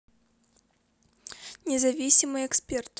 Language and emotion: Russian, neutral